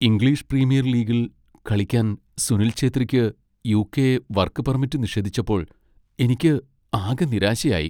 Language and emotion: Malayalam, sad